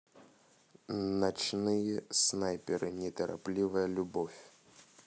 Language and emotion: Russian, neutral